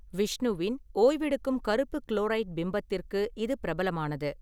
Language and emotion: Tamil, neutral